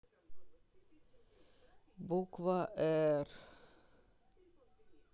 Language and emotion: Russian, sad